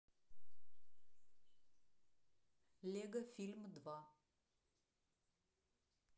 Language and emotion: Russian, neutral